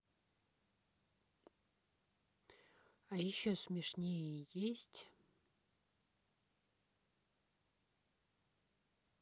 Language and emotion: Russian, neutral